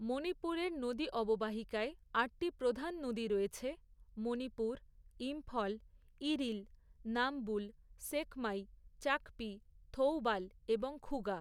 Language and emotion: Bengali, neutral